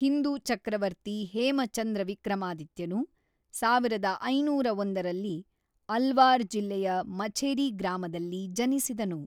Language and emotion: Kannada, neutral